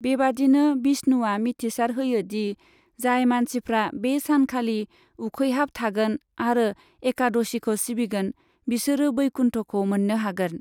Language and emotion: Bodo, neutral